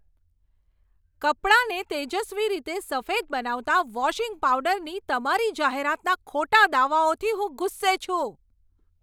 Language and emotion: Gujarati, angry